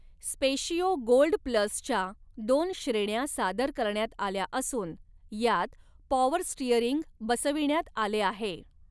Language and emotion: Marathi, neutral